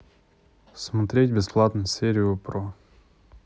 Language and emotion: Russian, neutral